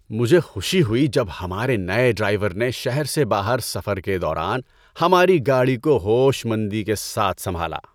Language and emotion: Urdu, happy